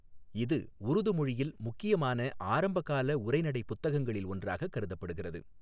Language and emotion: Tamil, neutral